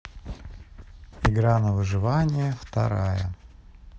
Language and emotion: Russian, neutral